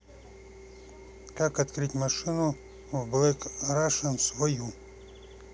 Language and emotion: Russian, neutral